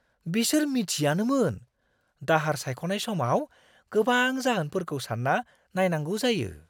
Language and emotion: Bodo, surprised